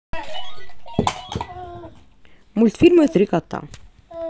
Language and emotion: Russian, neutral